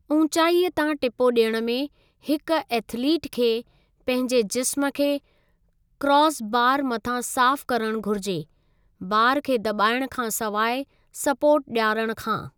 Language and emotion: Sindhi, neutral